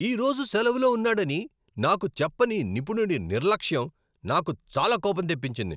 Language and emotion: Telugu, angry